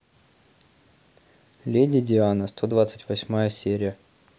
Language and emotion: Russian, neutral